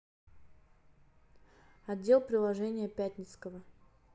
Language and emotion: Russian, neutral